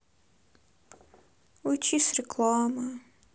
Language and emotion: Russian, sad